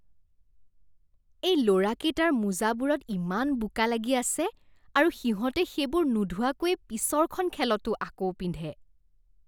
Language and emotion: Assamese, disgusted